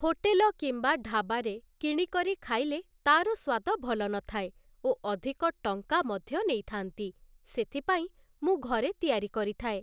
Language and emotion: Odia, neutral